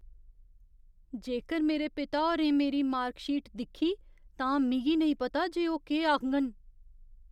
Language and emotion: Dogri, fearful